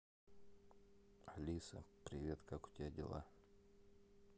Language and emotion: Russian, neutral